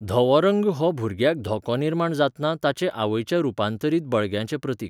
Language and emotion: Goan Konkani, neutral